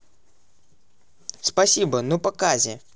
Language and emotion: Russian, neutral